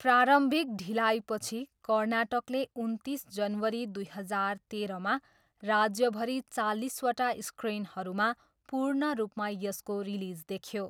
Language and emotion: Nepali, neutral